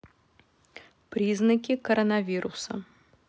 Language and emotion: Russian, neutral